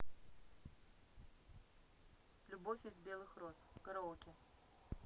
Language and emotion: Russian, neutral